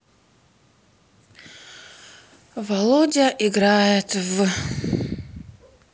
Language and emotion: Russian, sad